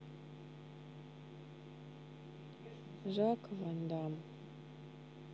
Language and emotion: Russian, neutral